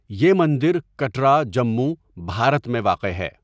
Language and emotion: Urdu, neutral